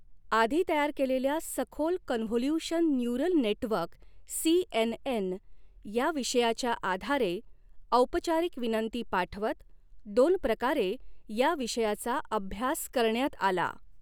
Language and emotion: Marathi, neutral